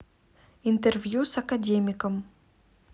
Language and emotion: Russian, neutral